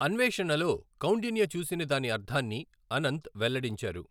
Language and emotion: Telugu, neutral